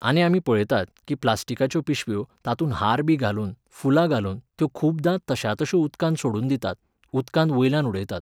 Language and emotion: Goan Konkani, neutral